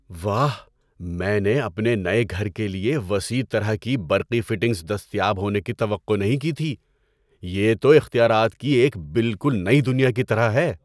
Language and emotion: Urdu, surprised